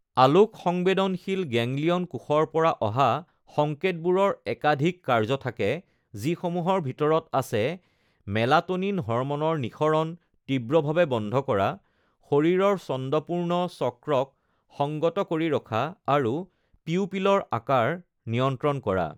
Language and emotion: Assamese, neutral